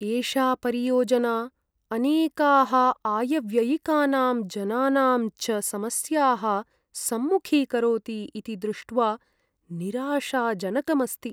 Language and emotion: Sanskrit, sad